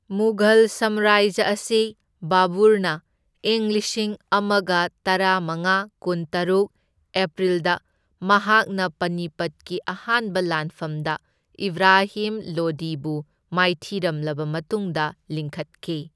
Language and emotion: Manipuri, neutral